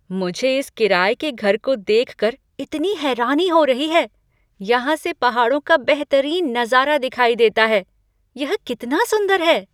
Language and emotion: Hindi, surprised